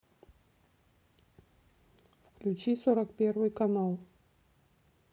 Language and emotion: Russian, neutral